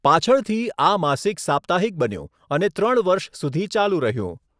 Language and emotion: Gujarati, neutral